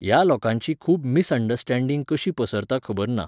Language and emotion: Goan Konkani, neutral